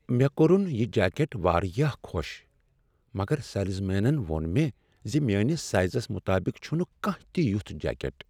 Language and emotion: Kashmiri, sad